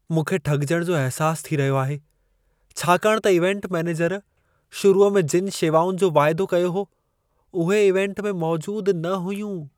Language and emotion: Sindhi, sad